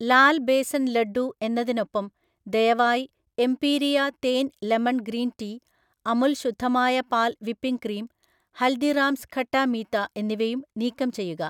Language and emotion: Malayalam, neutral